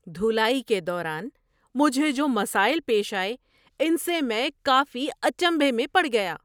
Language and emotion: Urdu, surprised